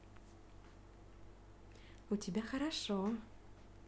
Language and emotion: Russian, positive